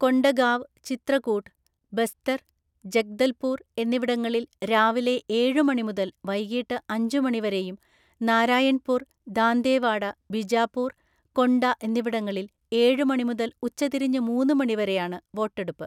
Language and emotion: Malayalam, neutral